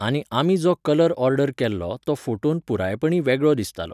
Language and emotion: Goan Konkani, neutral